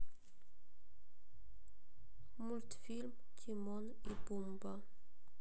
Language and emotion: Russian, sad